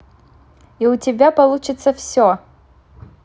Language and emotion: Russian, positive